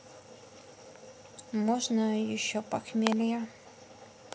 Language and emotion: Russian, neutral